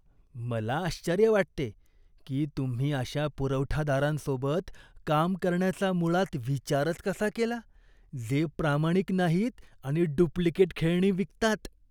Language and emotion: Marathi, disgusted